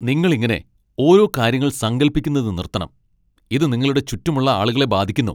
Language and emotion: Malayalam, angry